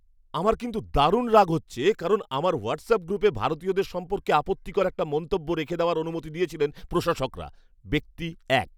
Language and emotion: Bengali, angry